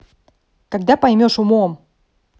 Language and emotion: Russian, angry